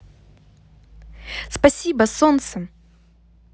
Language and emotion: Russian, positive